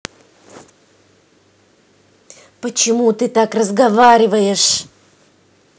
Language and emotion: Russian, angry